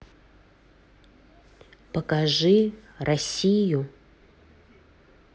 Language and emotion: Russian, neutral